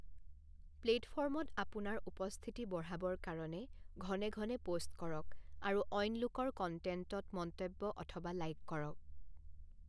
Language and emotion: Assamese, neutral